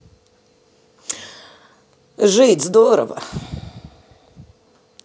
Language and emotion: Russian, neutral